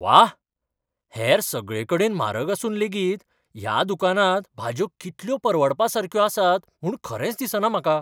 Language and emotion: Goan Konkani, surprised